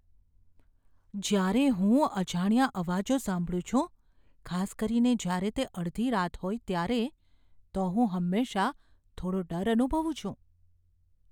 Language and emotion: Gujarati, fearful